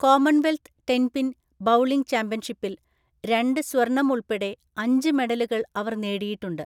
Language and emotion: Malayalam, neutral